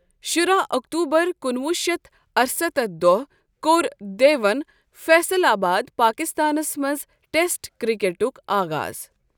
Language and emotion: Kashmiri, neutral